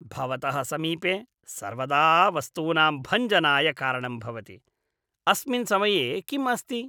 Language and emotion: Sanskrit, disgusted